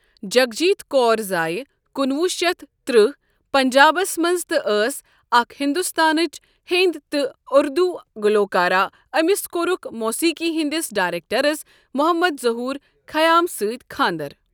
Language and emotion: Kashmiri, neutral